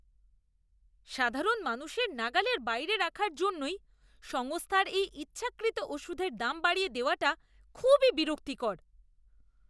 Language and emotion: Bengali, disgusted